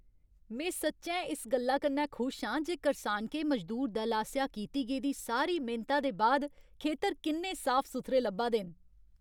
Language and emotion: Dogri, happy